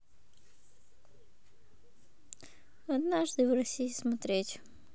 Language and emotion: Russian, neutral